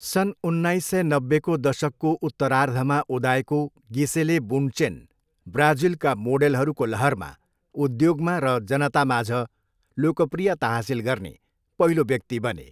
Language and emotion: Nepali, neutral